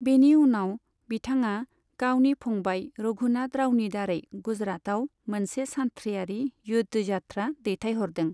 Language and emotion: Bodo, neutral